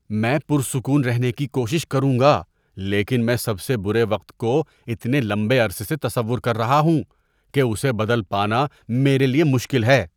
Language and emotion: Urdu, disgusted